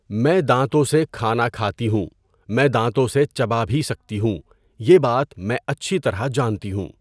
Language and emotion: Urdu, neutral